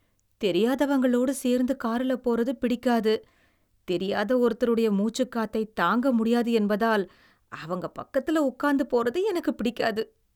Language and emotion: Tamil, disgusted